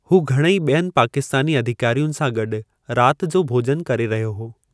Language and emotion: Sindhi, neutral